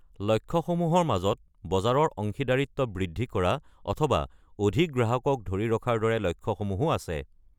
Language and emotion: Assamese, neutral